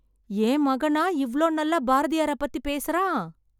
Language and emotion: Tamil, happy